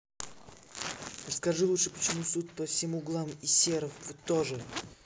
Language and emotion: Russian, angry